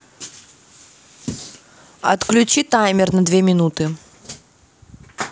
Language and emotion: Russian, neutral